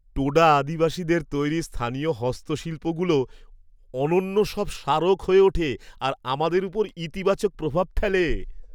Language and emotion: Bengali, happy